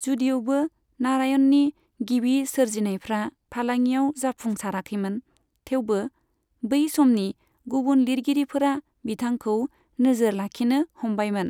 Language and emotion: Bodo, neutral